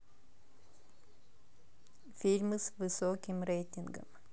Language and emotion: Russian, neutral